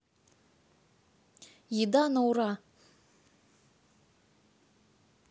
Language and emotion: Russian, neutral